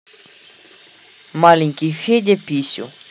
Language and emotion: Russian, neutral